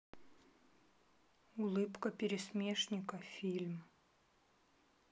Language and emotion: Russian, neutral